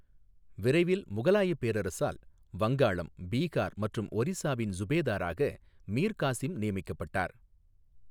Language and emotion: Tamil, neutral